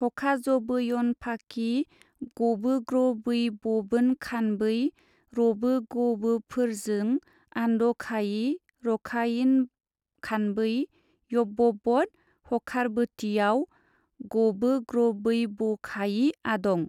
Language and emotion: Bodo, neutral